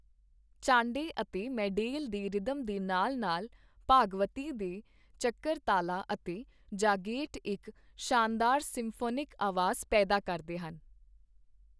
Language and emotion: Punjabi, neutral